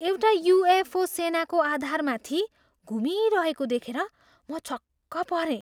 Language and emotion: Nepali, surprised